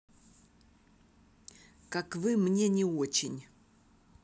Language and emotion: Russian, neutral